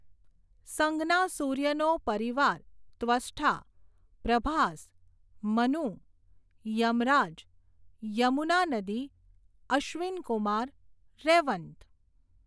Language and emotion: Gujarati, neutral